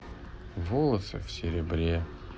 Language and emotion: Russian, sad